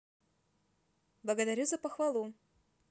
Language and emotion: Russian, positive